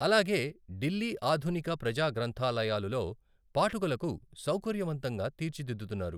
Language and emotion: Telugu, neutral